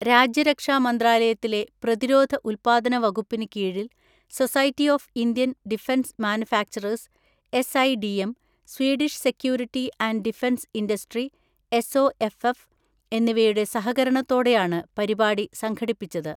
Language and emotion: Malayalam, neutral